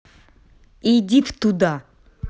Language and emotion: Russian, angry